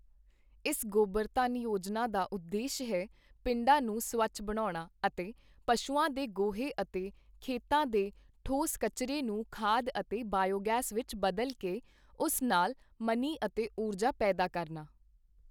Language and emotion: Punjabi, neutral